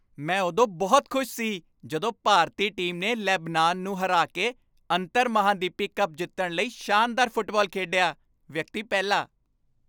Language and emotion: Punjabi, happy